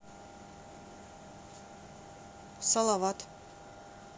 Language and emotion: Russian, neutral